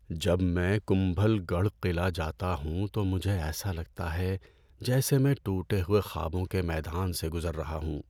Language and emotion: Urdu, sad